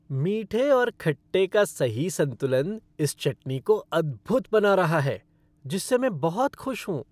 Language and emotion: Hindi, happy